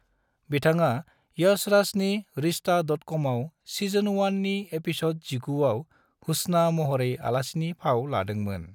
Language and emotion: Bodo, neutral